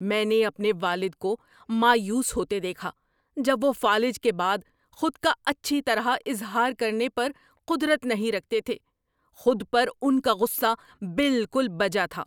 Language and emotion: Urdu, angry